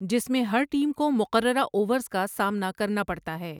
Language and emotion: Urdu, neutral